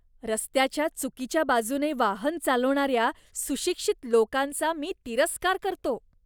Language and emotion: Marathi, disgusted